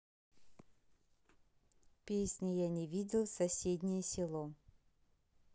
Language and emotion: Russian, neutral